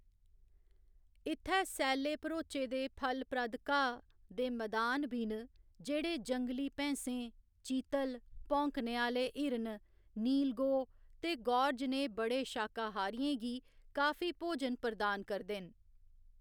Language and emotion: Dogri, neutral